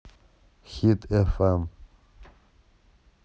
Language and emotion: Russian, neutral